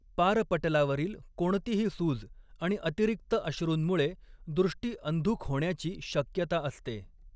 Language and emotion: Marathi, neutral